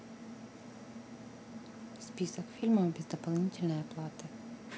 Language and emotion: Russian, neutral